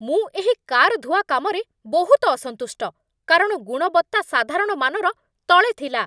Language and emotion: Odia, angry